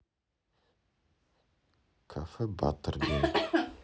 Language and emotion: Russian, neutral